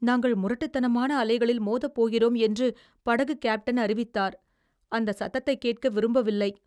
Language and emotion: Tamil, fearful